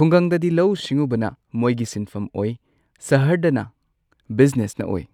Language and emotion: Manipuri, neutral